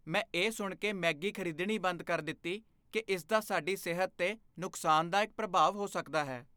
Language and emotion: Punjabi, fearful